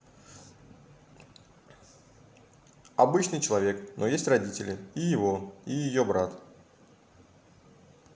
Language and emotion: Russian, neutral